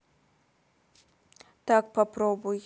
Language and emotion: Russian, neutral